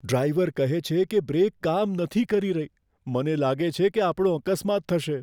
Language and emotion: Gujarati, fearful